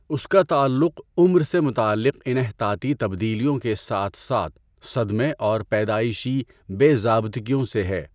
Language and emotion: Urdu, neutral